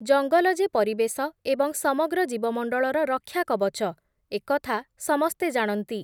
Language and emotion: Odia, neutral